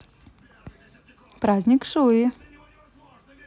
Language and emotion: Russian, positive